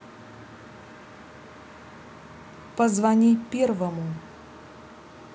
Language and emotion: Russian, neutral